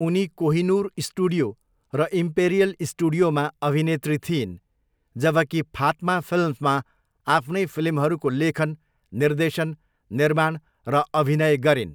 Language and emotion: Nepali, neutral